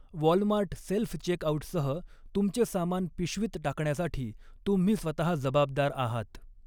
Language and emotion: Marathi, neutral